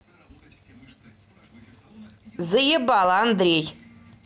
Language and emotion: Russian, angry